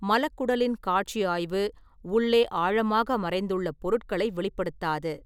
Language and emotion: Tamil, neutral